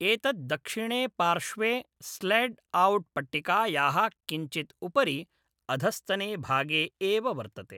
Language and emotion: Sanskrit, neutral